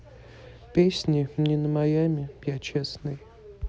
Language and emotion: Russian, neutral